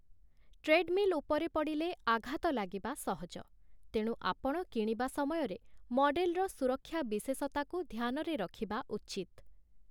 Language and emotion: Odia, neutral